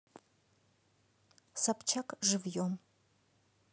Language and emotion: Russian, neutral